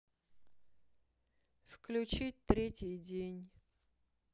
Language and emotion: Russian, sad